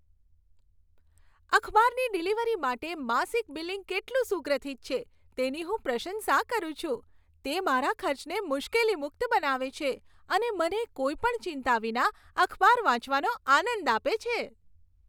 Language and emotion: Gujarati, happy